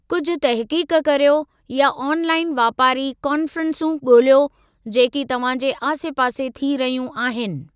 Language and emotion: Sindhi, neutral